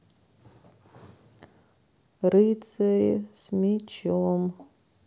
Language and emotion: Russian, sad